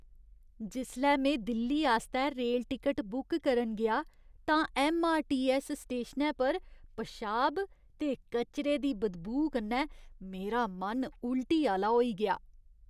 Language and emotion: Dogri, disgusted